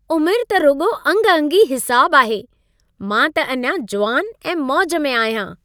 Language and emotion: Sindhi, happy